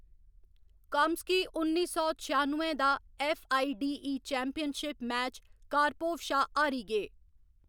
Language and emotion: Dogri, neutral